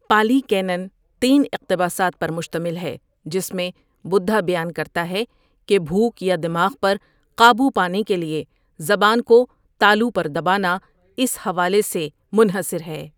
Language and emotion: Urdu, neutral